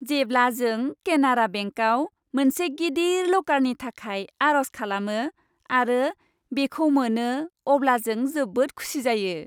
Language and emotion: Bodo, happy